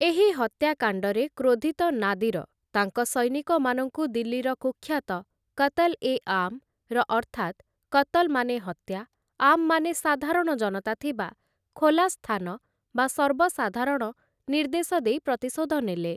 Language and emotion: Odia, neutral